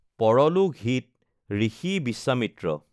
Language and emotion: Assamese, neutral